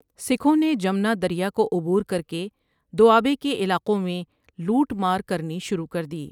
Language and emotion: Urdu, neutral